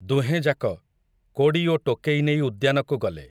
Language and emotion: Odia, neutral